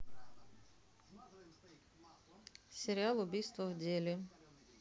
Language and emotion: Russian, neutral